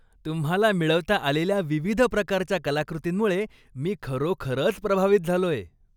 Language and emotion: Marathi, happy